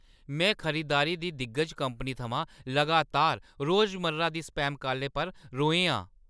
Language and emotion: Dogri, angry